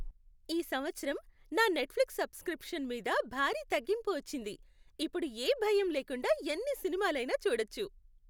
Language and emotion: Telugu, happy